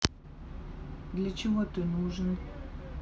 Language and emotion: Russian, neutral